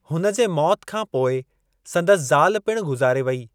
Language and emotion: Sindhi, neutral